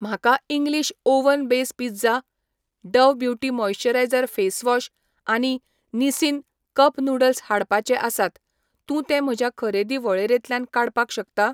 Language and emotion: Goan Konkani, neutral